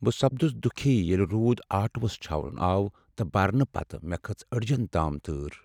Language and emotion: Kashmiri, sad